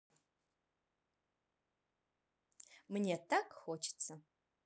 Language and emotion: Russian, positive